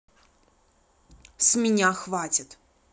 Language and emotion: Russian, angry